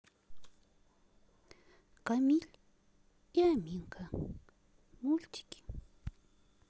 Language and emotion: Russian, sad